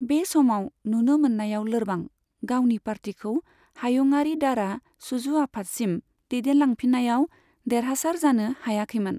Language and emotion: Bodo, neutral